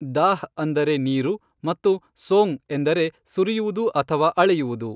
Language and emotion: Kannada, neutral